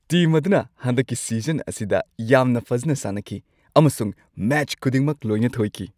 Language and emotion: Manipuri, happy